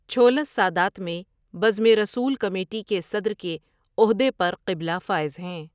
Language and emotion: Urdu, neutral